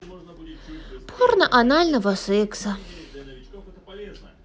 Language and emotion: Russian, sad